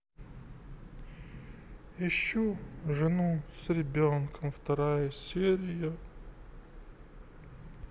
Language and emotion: Russian, sad